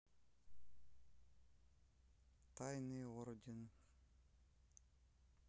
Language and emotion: Russian, sad